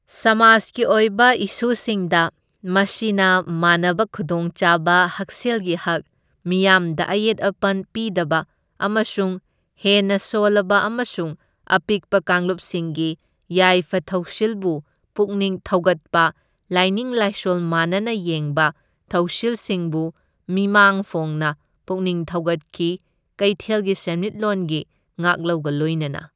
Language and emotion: Manipuri, neutral